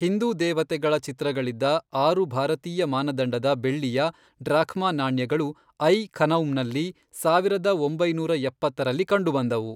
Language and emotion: Kannada, neutral